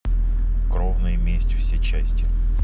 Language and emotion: Russian, neutral